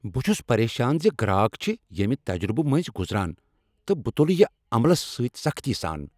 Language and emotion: Kashmiri, angry